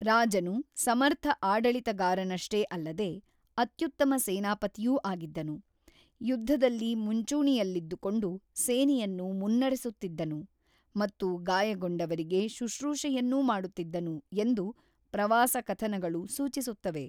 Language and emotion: Kannada, neutral